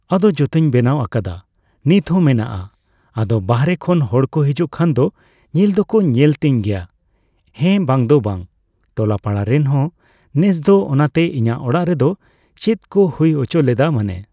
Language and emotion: Santali, neutral